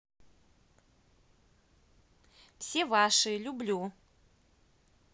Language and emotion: Russian, positive